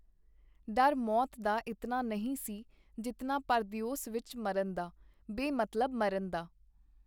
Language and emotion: Punjabi, neutral